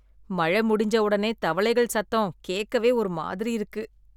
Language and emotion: Tamil, disgusted